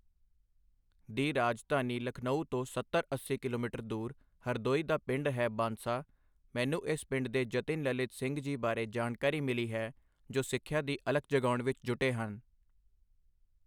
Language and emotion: Punjabi, neutral